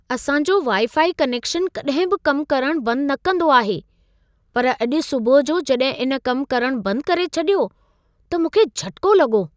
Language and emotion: Sindhi, surprised